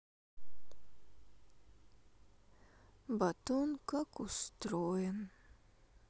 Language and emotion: Russian, sad